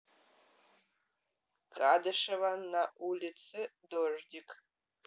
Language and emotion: Russian, neutral